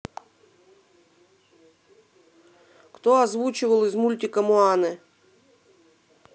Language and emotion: Russian, neutral